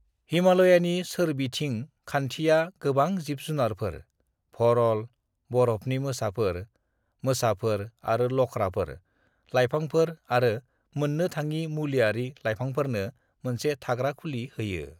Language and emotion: Bodo, neutral